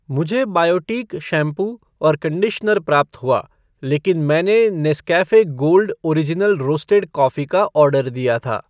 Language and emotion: Hindi, neutral